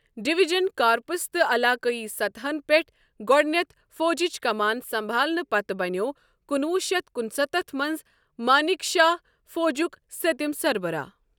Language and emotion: Kashmiri, neutral